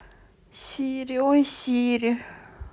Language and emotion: Russian, sad